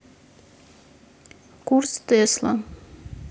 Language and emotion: Russian, neutral